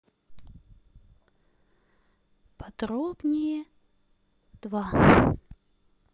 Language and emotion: Russian, sad